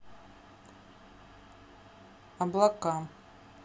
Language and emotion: Russian, neutral